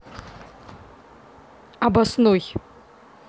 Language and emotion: Russian, neutral